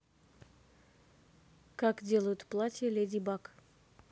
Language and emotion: Russian, neutral